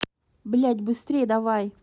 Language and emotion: Russian, angry